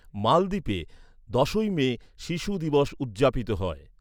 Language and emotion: Bengali, neutral